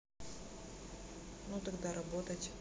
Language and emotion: Russian, neutral